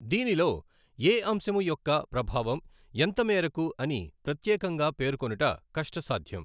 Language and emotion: Telugu, neutral